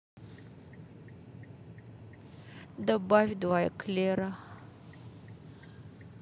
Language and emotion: Russian, sad